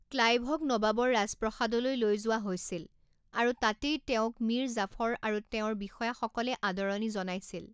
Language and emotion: Assamese, neutral